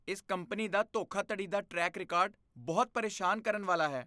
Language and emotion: Punjabi, disgusted